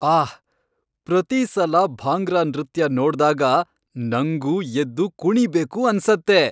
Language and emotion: Kannada, happy